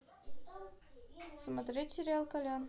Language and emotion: Russian, neutral